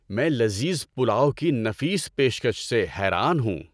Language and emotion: Urdu, happy